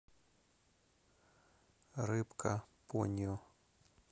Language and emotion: Russian, neutral